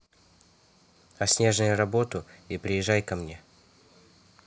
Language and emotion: Russian, neutral